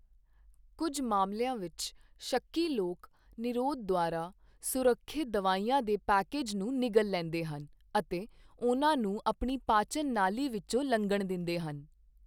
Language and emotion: Punjabi, neutral